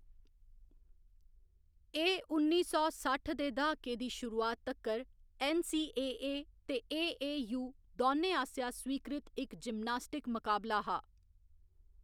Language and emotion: Dogri, neutral